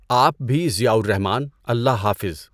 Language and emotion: Urdu, neutral